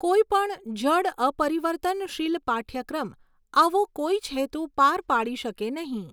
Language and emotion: Gujarati, neutral